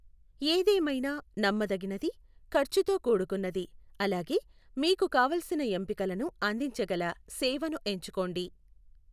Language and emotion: Telugu, neutral